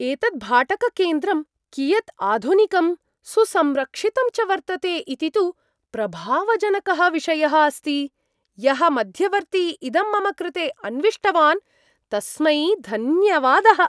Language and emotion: Sanskrit, surprised